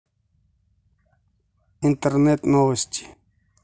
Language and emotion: Russian, neutral